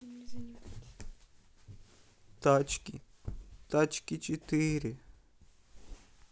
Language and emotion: Russian, sad